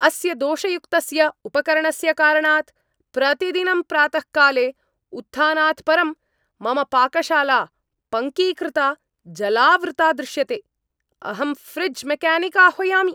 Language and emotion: Sanskrit, angry